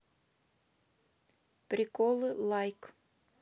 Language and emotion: Russian, neutral